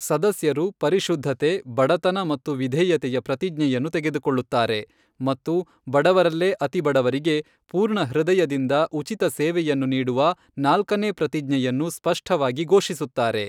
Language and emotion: Kannada, neutral